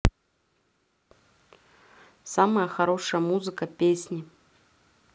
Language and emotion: Russian, neutral